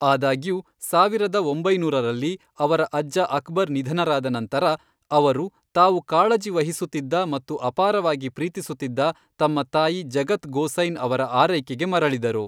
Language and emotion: Kannada, neutral